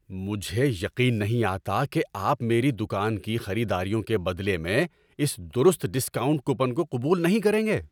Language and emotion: Urdu, angry